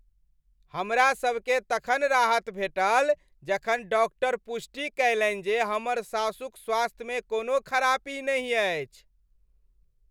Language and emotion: Maithili, happy